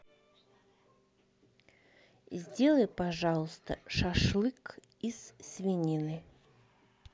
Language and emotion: Russian, neutral